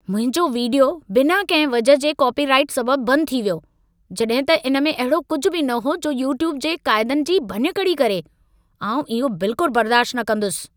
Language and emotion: Sindhi, angry